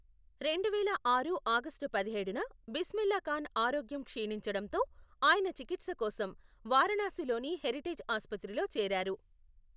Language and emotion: Telugu, neutral